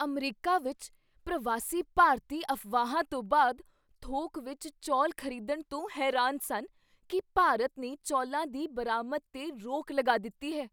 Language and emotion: Punjabi, surprised